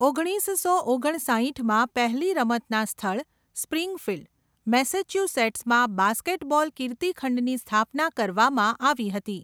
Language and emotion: Gujarati, neutral